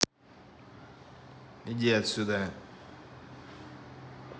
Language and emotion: Russian, angry